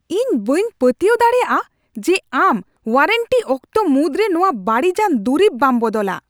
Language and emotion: Santali, angry